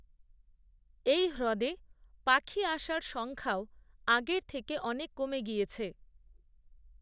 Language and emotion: Bengali, neutral